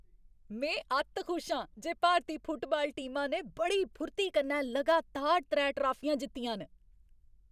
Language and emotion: Dogri, happy